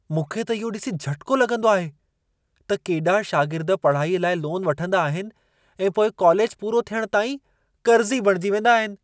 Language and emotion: Sindhi, surprised